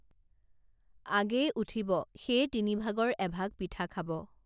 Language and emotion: Assamese, neutral